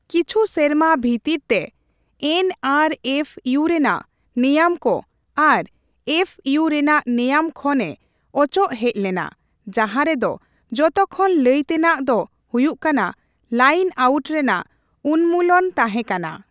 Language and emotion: Santali, neutral